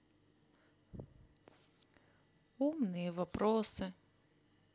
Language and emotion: Russian, sad